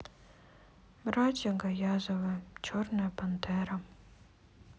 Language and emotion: Russian, sad